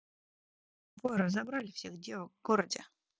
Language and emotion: Russian, neutral